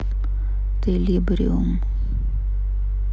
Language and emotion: Russian, sad